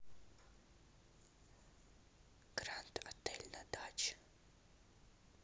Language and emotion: Russian, neutral